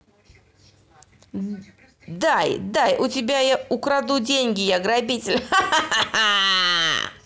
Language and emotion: Russian, positive